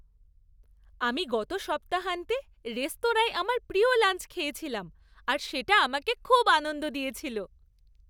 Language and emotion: Bengali, happy